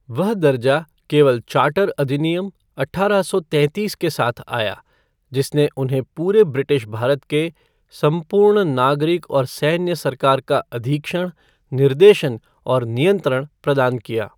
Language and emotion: Hindi, neutral